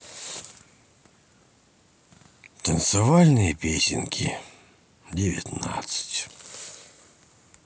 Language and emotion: Russian, sad